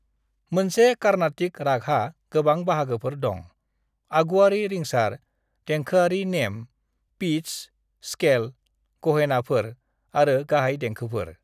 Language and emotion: Bodo, neutral